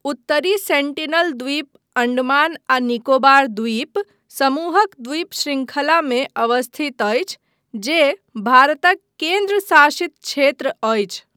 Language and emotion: Maithili, neutral